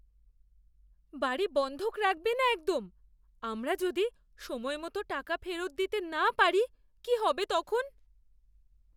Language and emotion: Bengali, fearful